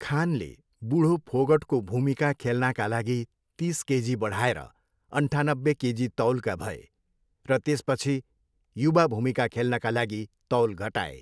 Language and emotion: Nepali, neutral